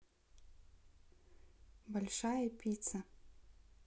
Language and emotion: Russian, neutral